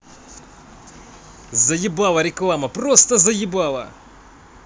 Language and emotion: Russian, angry